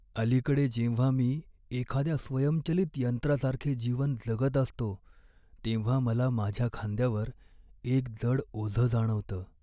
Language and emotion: Marathi, sad